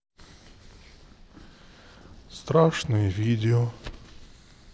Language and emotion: Russian, sad